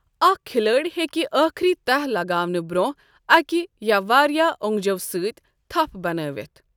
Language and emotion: Kashmiri, neutral